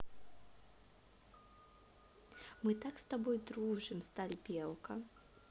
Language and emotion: Russian, positive